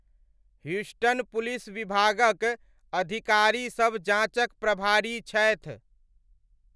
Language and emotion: Maithili, neutral